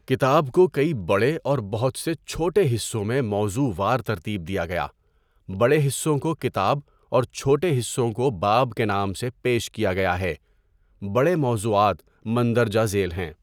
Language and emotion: Urdu, neutral